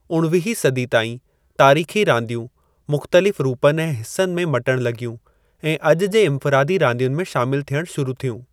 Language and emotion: Sindhi, neutral